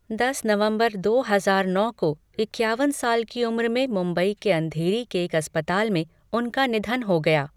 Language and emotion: Hindi, neutral